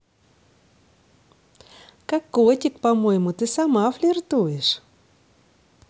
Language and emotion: Russian, positive